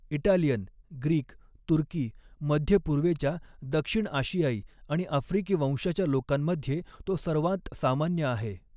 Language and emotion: Marathi, neutral